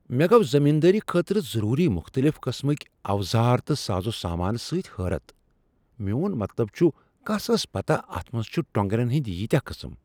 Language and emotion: Kashmiri, surprised